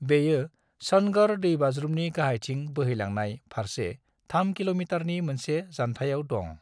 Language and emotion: Bodo, neutral